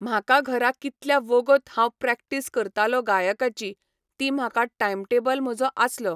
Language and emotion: Goan Konkani, neutral